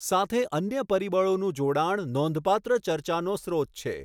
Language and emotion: Gujarati, neutral